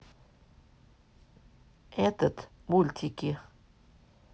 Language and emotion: Russian, neutral